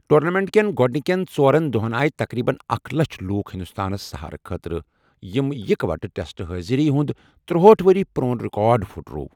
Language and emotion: Kashmiri, neutral